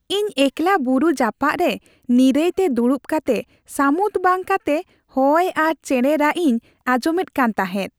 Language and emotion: Santali, happy